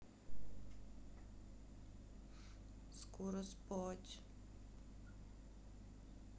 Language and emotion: Russian, sad